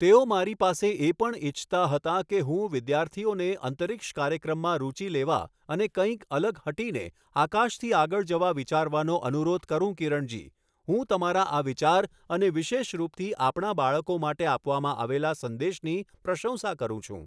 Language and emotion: Gujarati, neutral